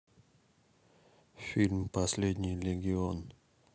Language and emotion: Russian, neutral